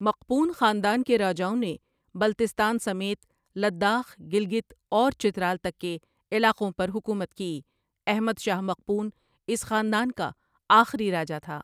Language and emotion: Urdu, neutral